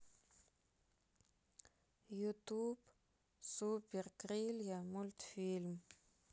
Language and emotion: Russian, sad